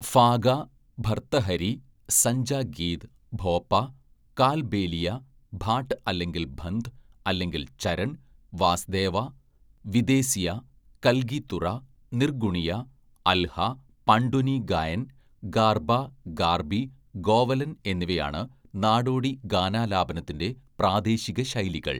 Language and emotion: Malayalam, neutral